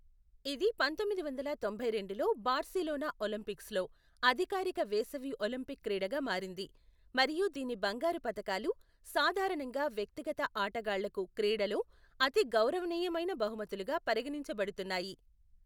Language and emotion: Telugu, neutral